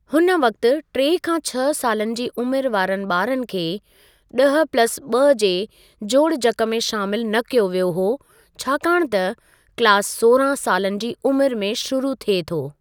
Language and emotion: Sindhi, neutral